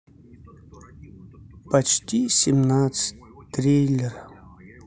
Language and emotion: Russian, sad